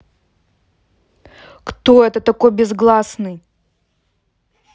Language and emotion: Russian, angry